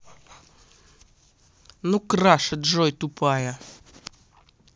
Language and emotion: Russian, angry